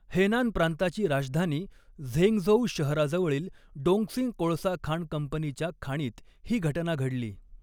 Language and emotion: Marathi, neutral